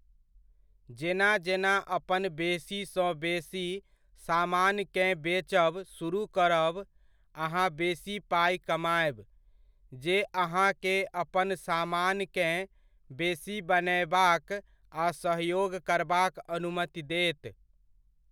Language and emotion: Maithili, neutral